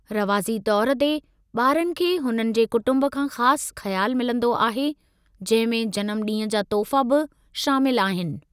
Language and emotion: Sindhi, neutral